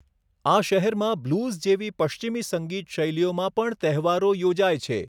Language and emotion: Gujarati, neutral